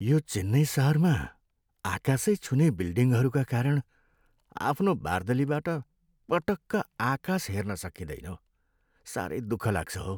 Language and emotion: Nepali, sad